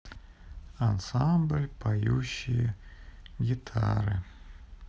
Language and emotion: Russian, sad